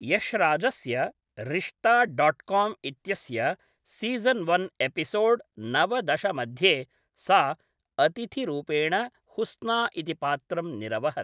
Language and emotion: Sanskrit, neutral